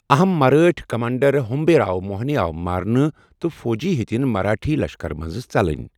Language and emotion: Kashmiri, neutral